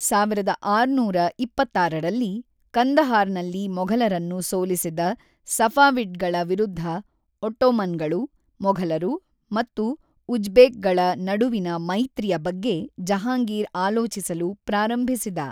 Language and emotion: Kannada, neutral